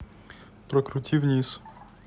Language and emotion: Russian, neutral